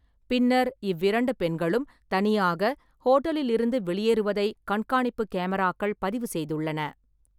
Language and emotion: Tamil, neutral